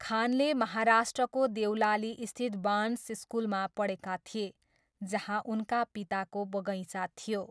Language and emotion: Nepali, neutral